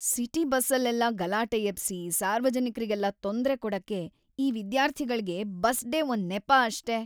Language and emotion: Kannada, disgusted